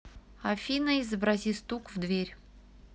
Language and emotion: Russian, neutral